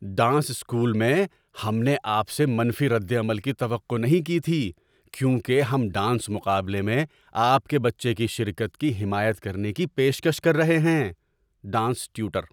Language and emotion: Urdu, surprised